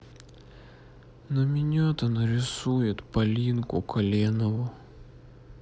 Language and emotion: Russian, sad